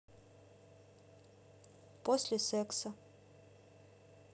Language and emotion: Russian, neutral